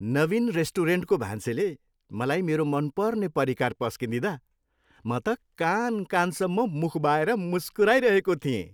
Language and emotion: Nepali, happy